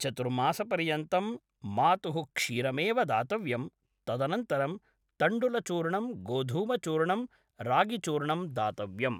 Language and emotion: Sanskrit, neutral